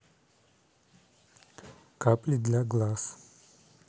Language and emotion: Russian, neutral